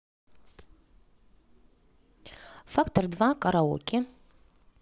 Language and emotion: Russian, neutral